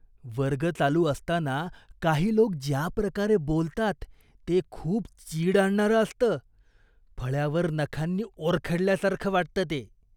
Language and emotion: Marathi, disgusted